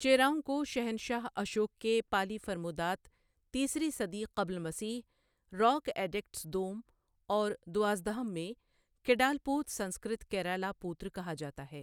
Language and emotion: Urdu, neutral